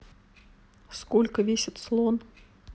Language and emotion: Russian, neutral